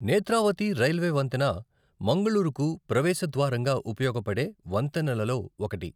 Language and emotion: Telugu, neutral